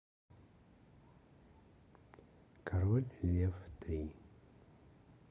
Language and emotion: Russian, neutral